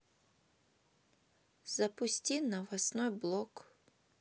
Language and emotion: Russian, neutral